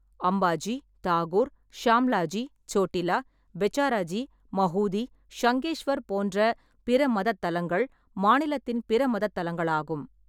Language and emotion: Tamil, neutral